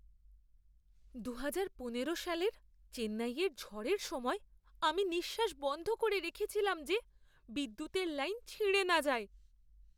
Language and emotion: Bengali, fearful